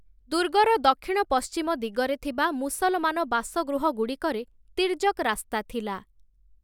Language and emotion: Odia, neutral